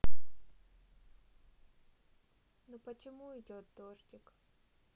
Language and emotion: Russian, sad